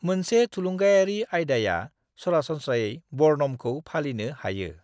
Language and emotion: Bodo, neutral